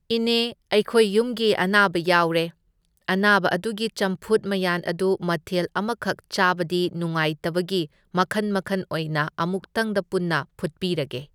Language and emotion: Manipuri, neutral